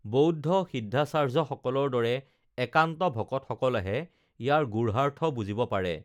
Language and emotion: Assamese, neutral